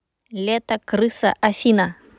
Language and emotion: Russian, neutral